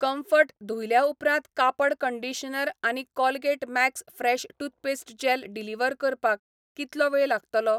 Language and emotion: Goan Konkani, neutral